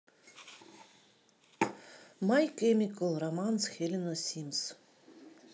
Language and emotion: Russian, neutral